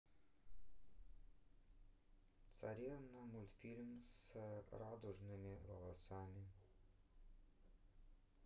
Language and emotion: Russian, neutral